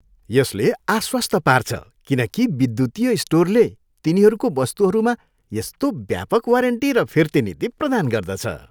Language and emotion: Nepali, happy